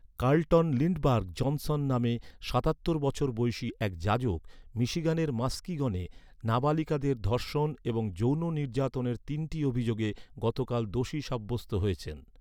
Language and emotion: Bengali, neutral